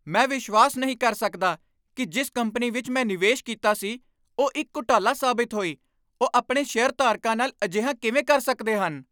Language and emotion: Punjabi, angry